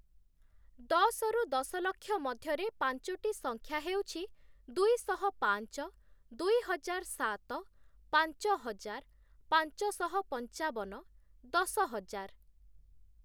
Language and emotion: Odia, neutral